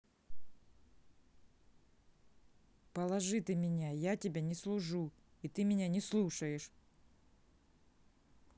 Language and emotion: Russian, angry